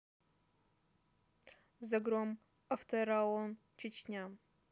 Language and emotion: Russian, neutral